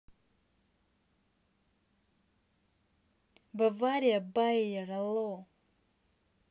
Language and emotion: Russian, neutral